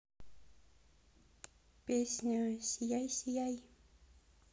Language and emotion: Russian, positive